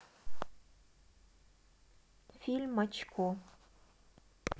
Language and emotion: Russian, neutral